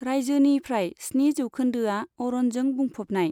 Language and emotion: Bodo, neutral